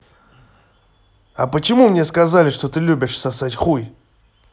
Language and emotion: Russian, angry